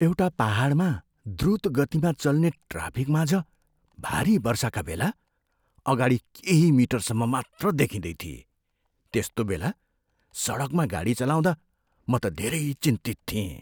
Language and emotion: Nepali, fearful